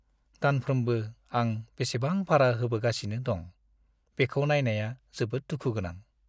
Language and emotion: Bodo, sad